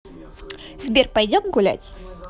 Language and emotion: Russian, positive